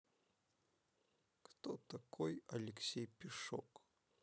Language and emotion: Russian, neutral